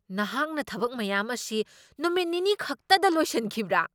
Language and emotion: Manipuri, surprised